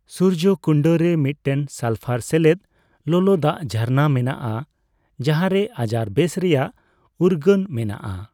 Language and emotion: Santali, neutral